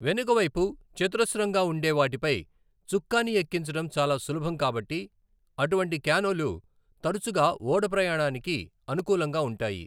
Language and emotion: Telugu, neutral